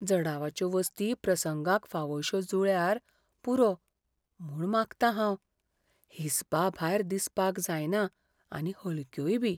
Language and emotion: Goan Konkani, fearful